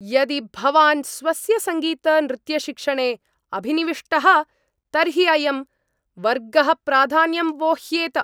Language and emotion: Sanskrit, angry